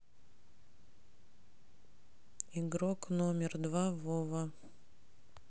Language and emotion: Russian, neutral